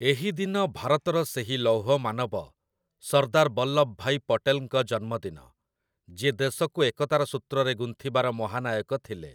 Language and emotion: Odia, neutral